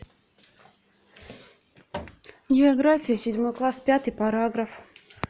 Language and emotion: Russian, neutral